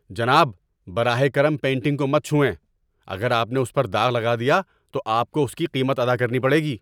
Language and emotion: Urdu, angry